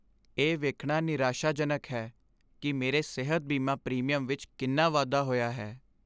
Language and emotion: Punjabi, sad